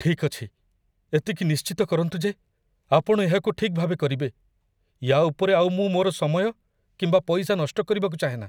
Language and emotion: Odia, fearful